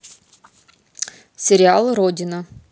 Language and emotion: Russian, neutral